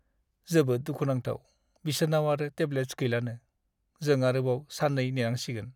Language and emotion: Bodo, sad